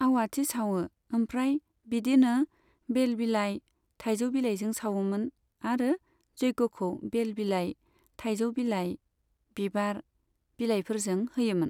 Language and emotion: Bodo, neutral